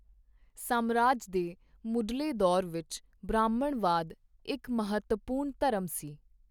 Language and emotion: Punjabi, neutral